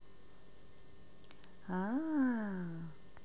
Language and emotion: Russian, positive